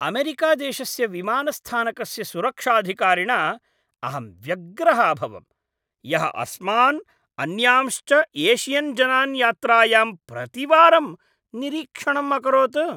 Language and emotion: Sanskrit, disgusted